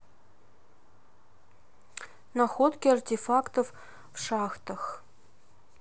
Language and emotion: Russian, neutral